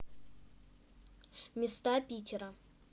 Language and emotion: Russian, neutral